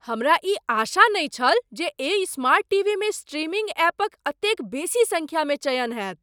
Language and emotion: Maithili, surprised